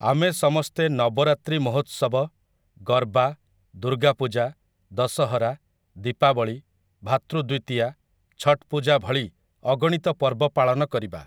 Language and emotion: Odia, neutral